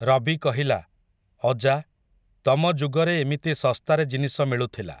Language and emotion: Odia, neutral